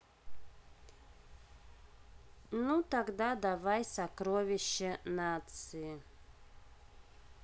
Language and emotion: Russian, neutral